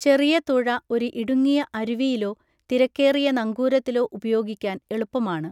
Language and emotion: Malayalam, neutral